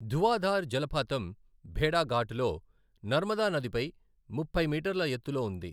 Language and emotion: Telugu, neutral